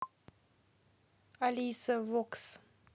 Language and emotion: Russian, neutral